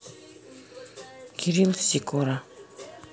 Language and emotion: Russian, neutral